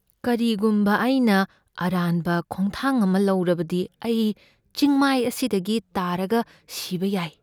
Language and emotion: Manipuri, fearful